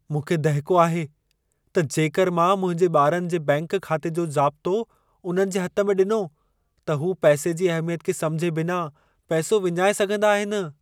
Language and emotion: Sindhi, fearful